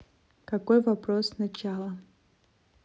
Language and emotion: Russian, neutral